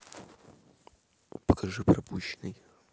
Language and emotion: Russian, neutral